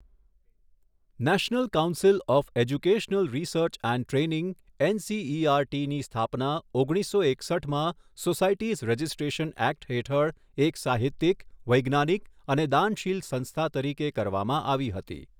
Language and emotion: Gujarati, neutral